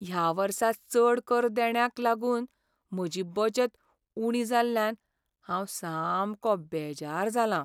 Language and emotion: Goan Konkani, sad